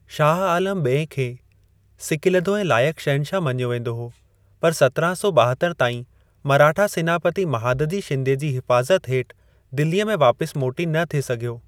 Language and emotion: Sindhi, neutral